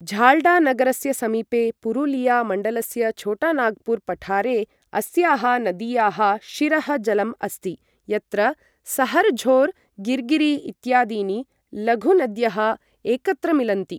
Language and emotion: Sanskrit, neutral